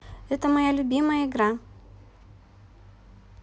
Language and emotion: Russian, neutral